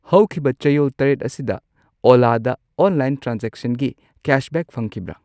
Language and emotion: Manipuri, neutral